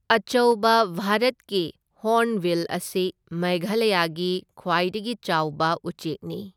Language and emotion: Manipuri, neutral